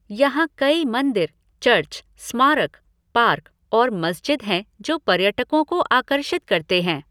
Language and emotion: Hindi, neutral